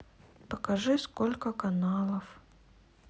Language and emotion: Russian, sad